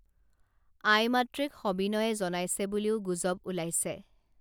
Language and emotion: Assamese, neutral